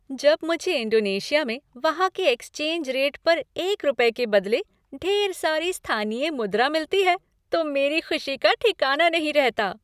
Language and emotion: Hindi, happy